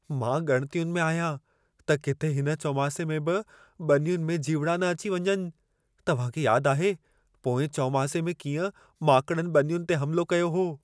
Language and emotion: Sindhi, fearful